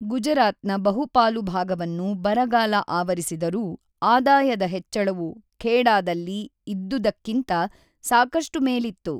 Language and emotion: Kannada, neutral